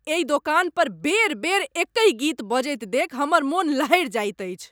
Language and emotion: Maithili, angry